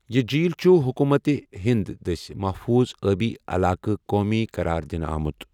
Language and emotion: Kashmiri, neutral